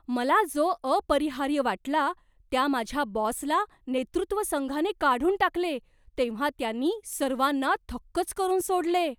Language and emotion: Marathi, surprised